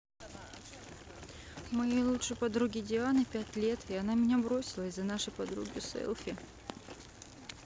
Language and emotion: Russian, sad